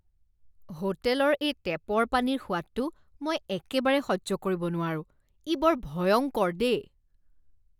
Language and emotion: Assamese, disgusted